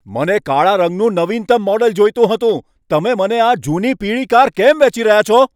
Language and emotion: Gujarati, angry